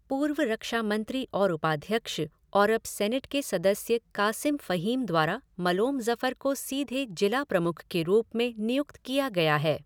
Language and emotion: Hindi, neutral